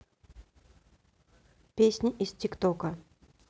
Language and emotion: Russian, neutral